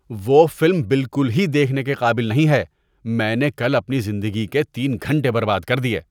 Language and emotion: Urdu, disgusted